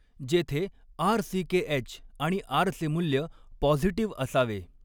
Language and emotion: Marathi, neutral